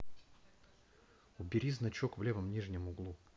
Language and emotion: Russian, neutral